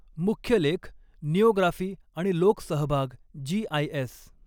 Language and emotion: Marathi, neutral